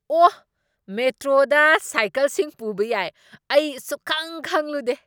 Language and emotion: Manipuri, surprised